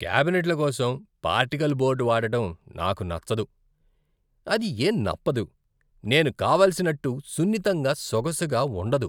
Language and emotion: Telugu, disgusted